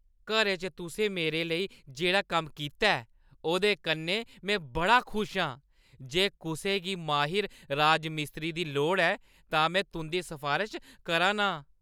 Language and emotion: Dogri, happy